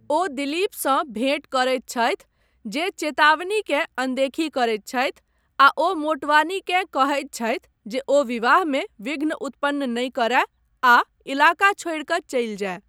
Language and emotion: Maithili, neutral